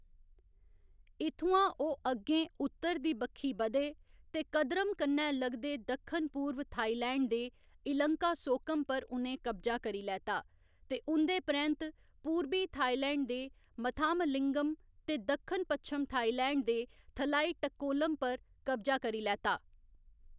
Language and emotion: Dogri, neutral